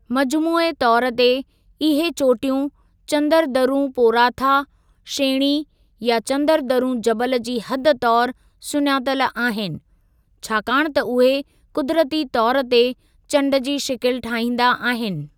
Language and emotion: Sindhi, neutral